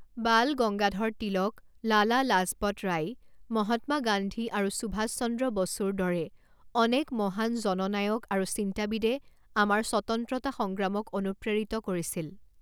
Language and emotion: Assamese, neutral